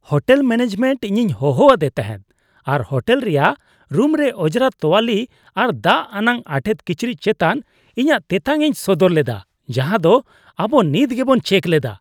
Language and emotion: Santali, disgusted